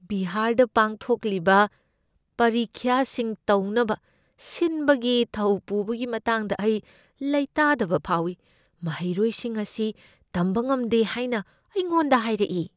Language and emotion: Manipuri, fearful